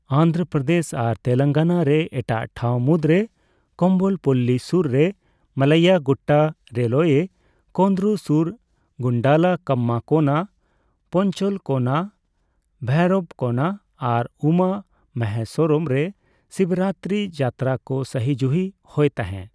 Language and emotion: Santali, neutral